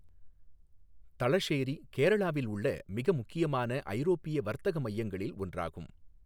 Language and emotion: Tamil, neutral